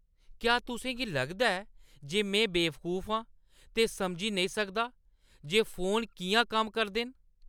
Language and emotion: Dogri, angry